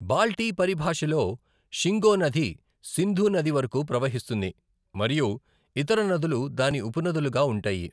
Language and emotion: Telugu, neutral